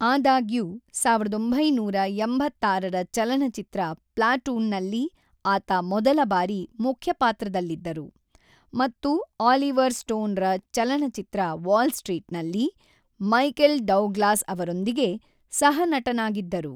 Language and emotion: Kannada, neutral